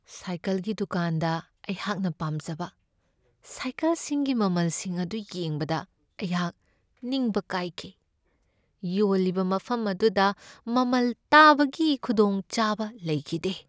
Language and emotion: Manipuri, sad